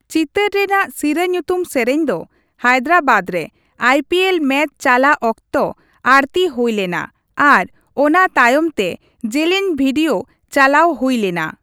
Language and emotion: Santali, neutral